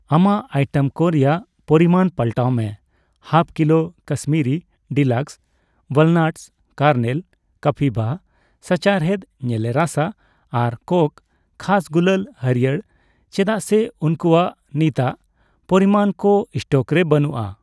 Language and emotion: Santali, neutral